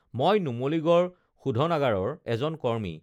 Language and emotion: Assamese, neutral